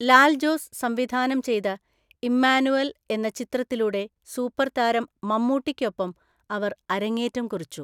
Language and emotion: Malayalam, neutral